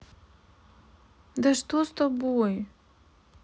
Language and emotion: Russian, sad